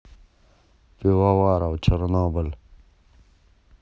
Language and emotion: Russian, neutral